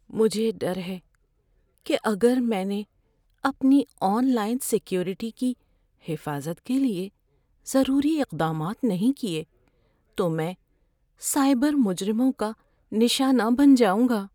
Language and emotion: Urdu, fearful